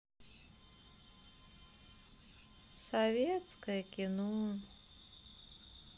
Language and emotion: Russian, sad